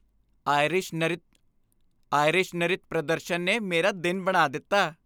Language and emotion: Punjabi, happy